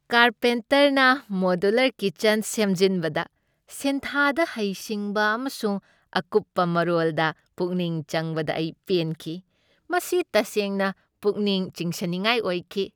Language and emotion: Manipuri, happy